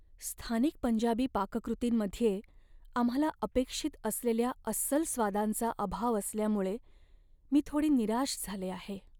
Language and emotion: Marathi, sad